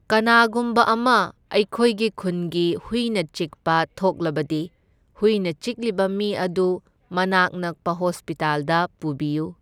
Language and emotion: Manipuri, neutral